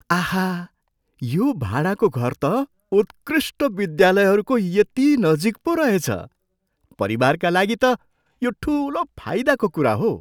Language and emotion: Nepali, surprised